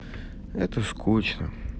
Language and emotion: Russian, sad